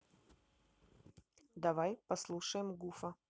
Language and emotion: Russian, neutral